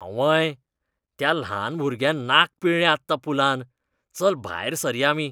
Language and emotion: Goan Konkani, disgusted